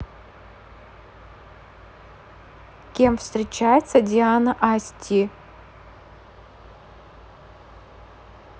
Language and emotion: Russian, neutral